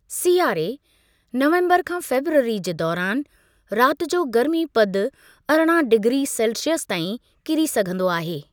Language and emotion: Sindhi, neutral